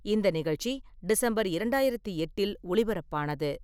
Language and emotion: Tamil, neutral